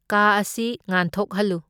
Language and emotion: Manipuri, neutral